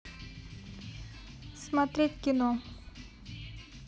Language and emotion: Russian, neutral